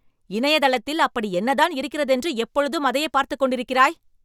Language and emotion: Tamil, angry